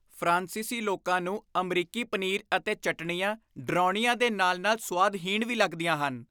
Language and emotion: Punjabi, disgusted